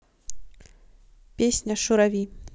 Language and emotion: Russian, neutral